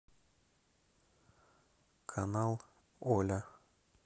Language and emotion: Russian, neutral